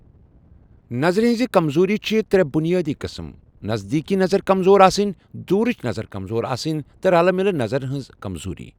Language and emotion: Kashmiri, neutral